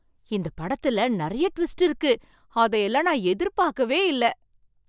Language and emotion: Tamil, surprised